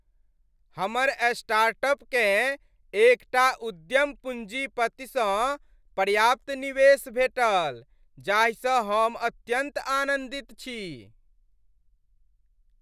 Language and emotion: Maithili, happy